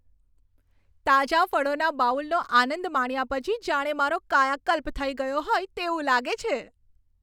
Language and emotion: Gujarati, happy